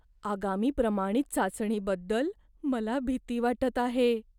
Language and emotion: Marathi, fearful